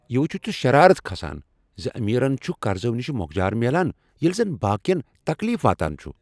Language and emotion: Kashmiri, angry